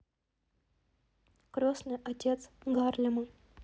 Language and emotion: Russian, neutral